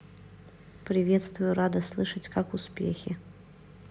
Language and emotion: Russian, neutral